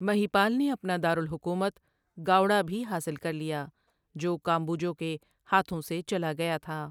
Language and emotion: Urdu, neutral